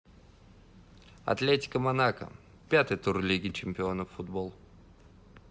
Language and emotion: Russian, neutral